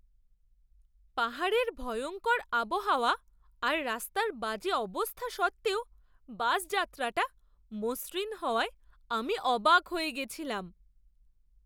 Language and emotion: Bengali, surprised